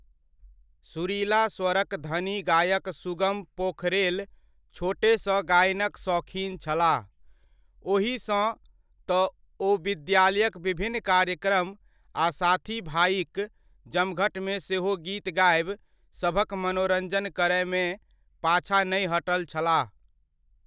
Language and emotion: Maithili, neutral